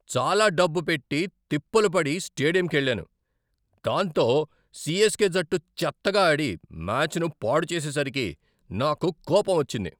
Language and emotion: Telugu, angry